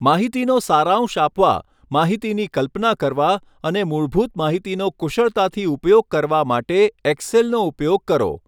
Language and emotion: Gujarati, neutral